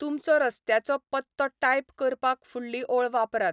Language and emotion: Goan Konkani, neutral